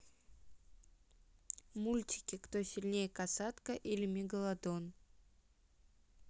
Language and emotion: Russian, neutral